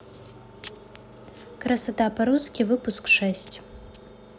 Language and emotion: Russian, neutral